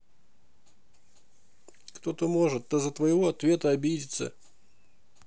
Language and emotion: Russian, neutral